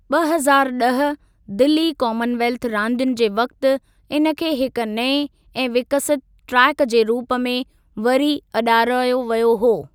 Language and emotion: Sindhi, neutral